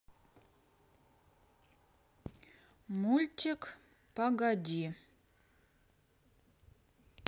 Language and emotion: Russian, neutral